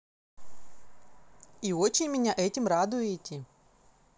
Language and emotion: Russian, positive